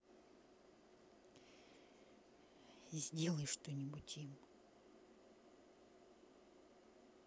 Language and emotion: Russian, angry